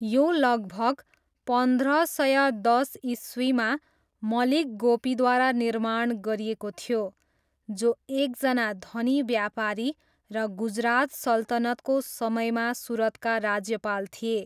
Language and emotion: Nepali, neutral